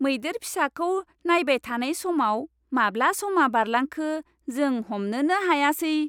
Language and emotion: Bodo, happy